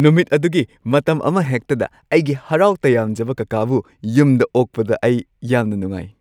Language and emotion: Manipuri, happy